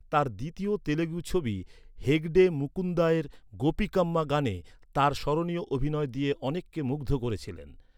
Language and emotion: Bengali, neutral